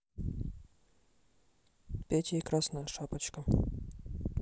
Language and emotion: Russian, neutral